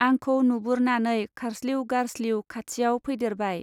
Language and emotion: Bodo, neutral